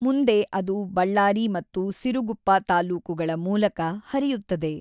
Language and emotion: Kannada, neutral